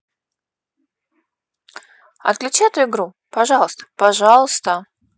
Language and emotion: Russian, neutral